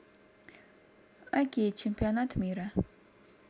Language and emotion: Russian, neutral